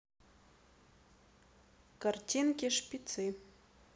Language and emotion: Russian, neutral